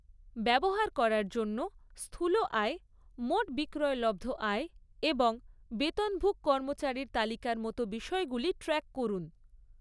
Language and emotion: Bengali, neutral